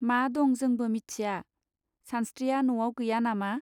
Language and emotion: Bodo, neutral